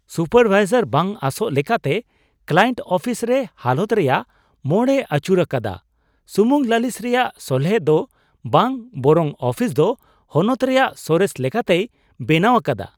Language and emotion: Santali, surprised